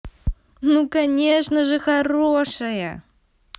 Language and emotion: Russian, positive